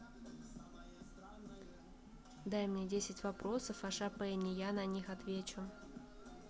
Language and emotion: Russian, neutral